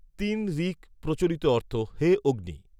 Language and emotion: Bengali, neutral